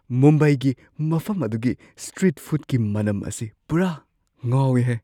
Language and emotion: Manipuri, surprised